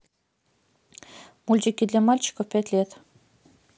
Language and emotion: Russian, neutral